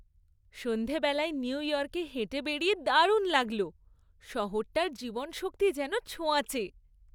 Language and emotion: Bengali, happy